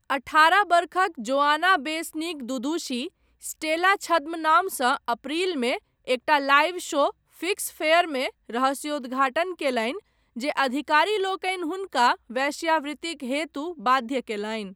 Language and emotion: Maithili, neutral